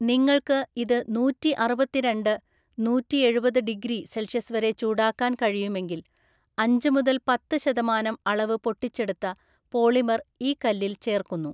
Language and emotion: Malayalam, neutral